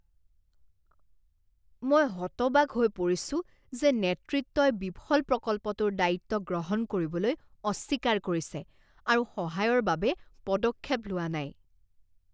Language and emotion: Assamese, disgusted